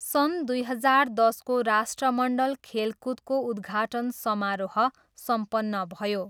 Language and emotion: Nepali, neutral